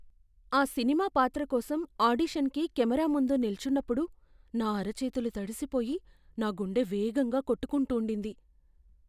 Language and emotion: Telugu, fearful